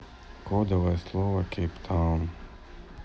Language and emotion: Russian, neutral